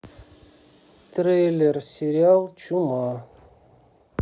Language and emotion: Russian, neutral